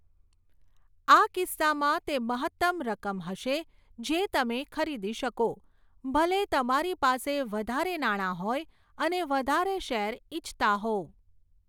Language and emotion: Gujarati, neutral